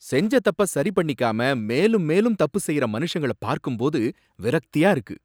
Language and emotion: Tamil, angry